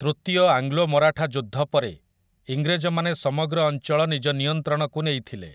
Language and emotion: Odia, neutral